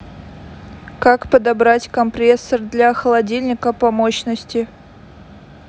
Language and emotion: Russian, neutral